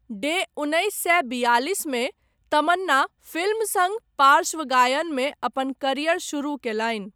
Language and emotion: Maithili, neutral